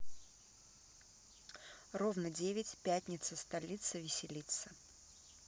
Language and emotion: Russian, neutral